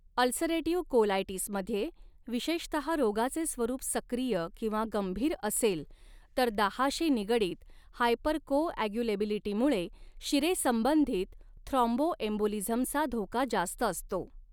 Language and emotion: Marathi, neutral